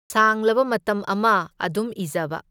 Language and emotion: Manipuri, neutral